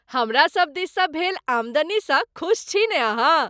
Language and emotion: Maithili, happy